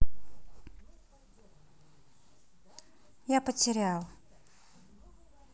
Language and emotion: Russian, sad